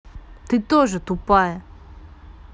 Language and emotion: Russian, angry